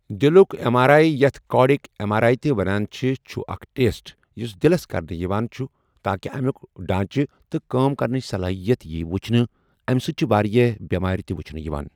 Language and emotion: Kashmiri, neutral